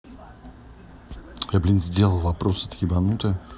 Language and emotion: Russian, angry